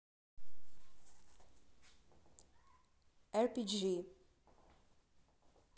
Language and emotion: Russian, neutral